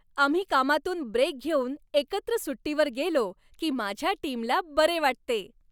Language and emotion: Marathi, happy